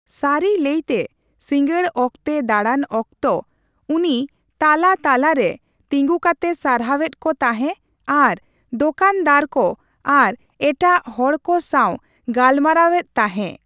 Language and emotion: Santali, neutral